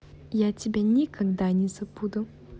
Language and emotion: Russian, positive